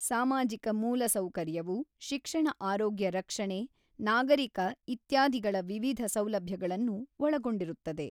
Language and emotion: Kannada, neutral